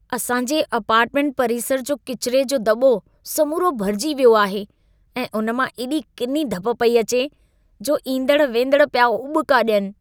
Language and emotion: Sindhi, disgusted